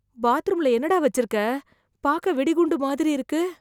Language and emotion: Tamil, fearful